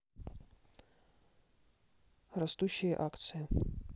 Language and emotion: Russian, neutral